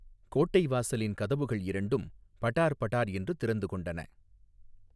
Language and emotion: Tamil, neutral